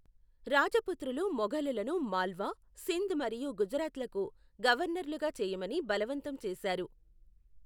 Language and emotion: Telugu, neutral